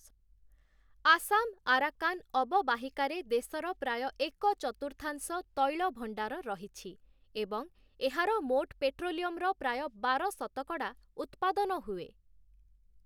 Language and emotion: Odia, neutral